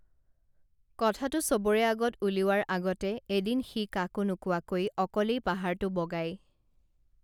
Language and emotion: Assamese, neutral